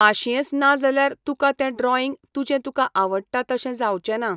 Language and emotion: Goan Konkani, neutral